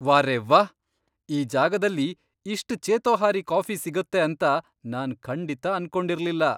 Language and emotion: Kannada, surprised